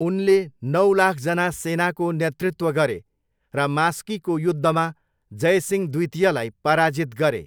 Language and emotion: Nepali, neutral